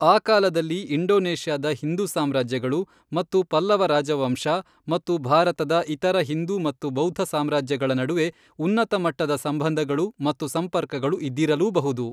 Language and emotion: Kannada, neutral